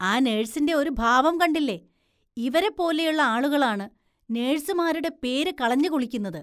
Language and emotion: Malayalam, disgusted